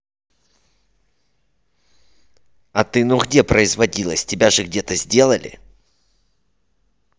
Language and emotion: Russian, angry